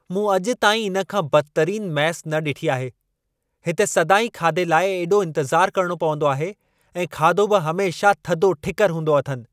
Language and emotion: Sindhi, angry